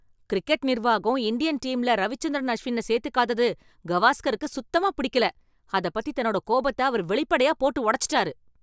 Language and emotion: Tamil, angry